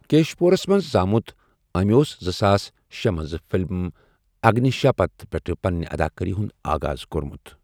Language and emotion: Kashmiri, neutral